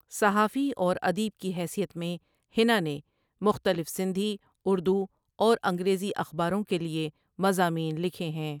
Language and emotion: Urdu, neutral